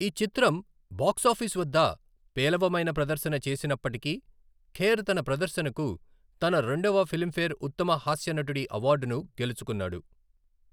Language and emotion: Telugu, neutral